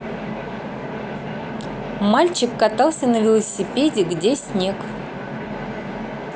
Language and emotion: Russian, neutral